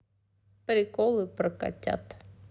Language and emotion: Russian, neutral